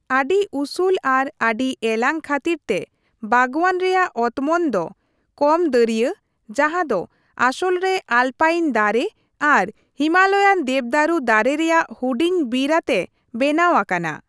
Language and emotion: Santali, neutral